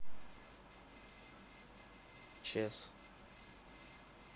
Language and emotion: Russian, neutral